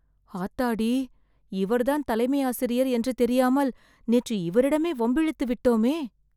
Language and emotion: Tamil, fearful